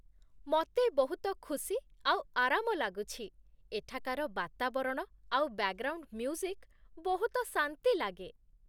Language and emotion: Odia, happy